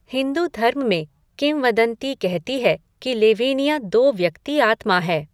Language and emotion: Hindi, neutral